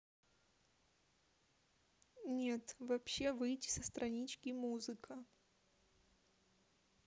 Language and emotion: Russian, neutral